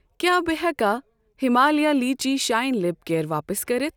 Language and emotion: Kashmiri, neutral